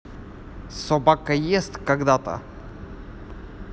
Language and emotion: Russian, neutral